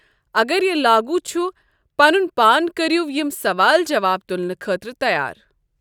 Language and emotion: Kashmiri, neutral